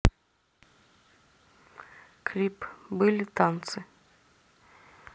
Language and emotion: Russian, neutral